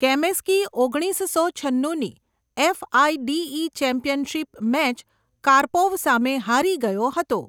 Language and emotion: Gujarati, neutral